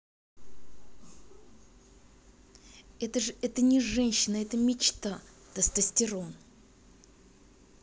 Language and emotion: Russian, neutral